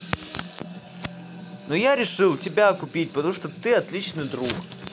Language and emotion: Russian, positive